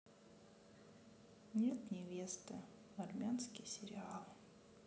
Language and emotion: Russian, sad